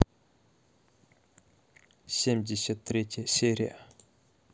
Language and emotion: Russian, neutral